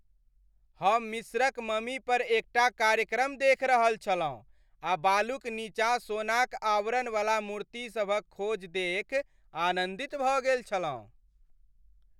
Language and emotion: Maithili, happy